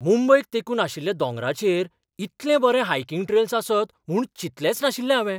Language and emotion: Goan Konkani, surprised